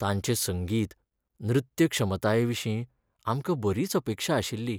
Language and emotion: Goan Konkani, sad